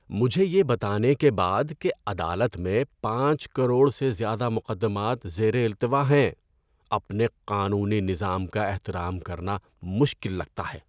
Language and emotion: Urdu, disgusted